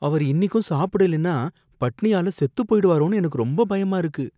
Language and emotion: Tamil, fearful